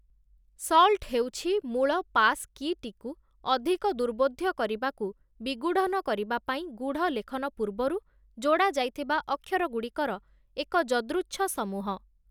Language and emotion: Odia, neutral